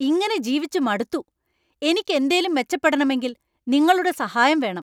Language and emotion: Malayalam, angry